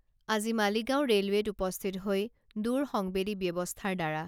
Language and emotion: Assamese, neutral